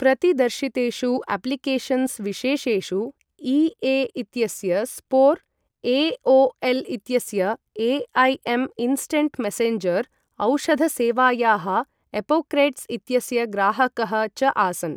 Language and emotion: Sanskrit, neutral